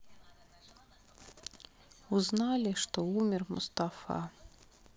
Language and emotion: Russian, sad